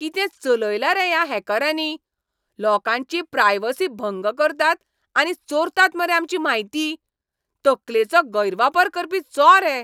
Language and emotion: Goan Konkani, angry